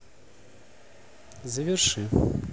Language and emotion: Russian, neutral